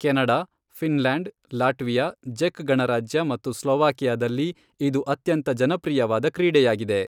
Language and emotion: Kannada, neutral